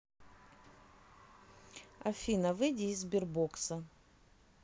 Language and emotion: Russian, neutral